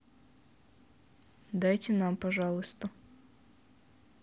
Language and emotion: Russian, neutral